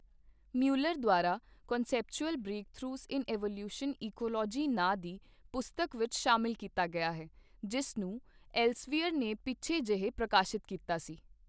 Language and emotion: Punjabi, neutral